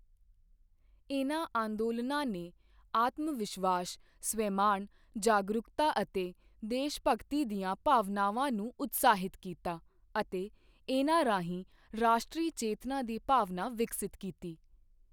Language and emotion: Punjabi, neutral